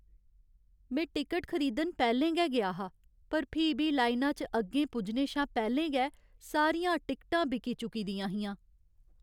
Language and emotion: Dogri, sad